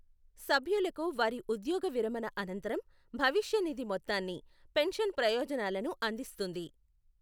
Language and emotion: Telugu, neutral